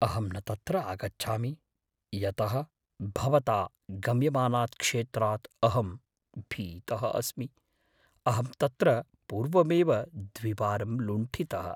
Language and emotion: Sanskrit, fearful